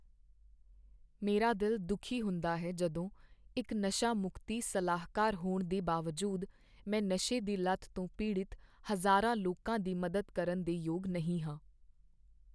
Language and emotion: Punjabi, sad